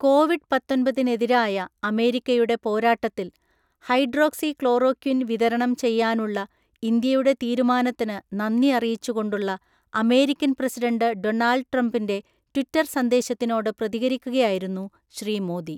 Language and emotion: Malayalam, neutral